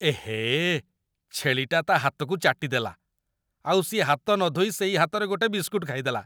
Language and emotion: Odia, disgusted